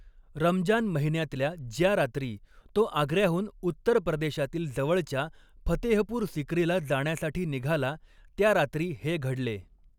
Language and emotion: Marathi, neutral